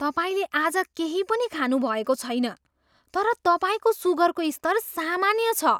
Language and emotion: Nepali, surprised